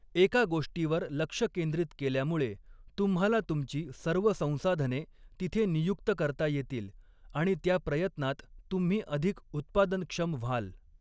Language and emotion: Marathi, neutral